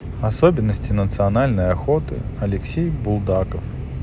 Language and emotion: Russian, neutral